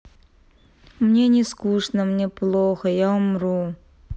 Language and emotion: Russian, sad